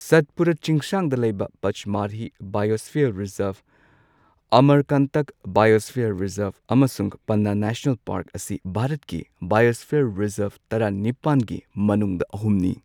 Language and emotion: Manipuri, neutral